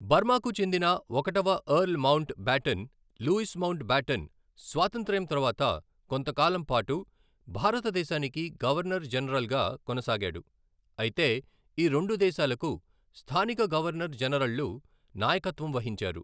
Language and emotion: Telugu, neutral